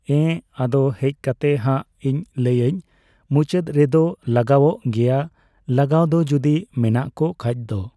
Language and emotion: Santali, neutral